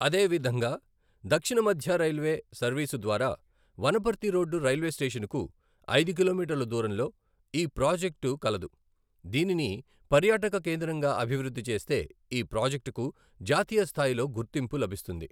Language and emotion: Telugu, neutral